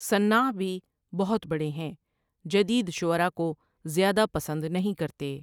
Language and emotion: Urdu, neutral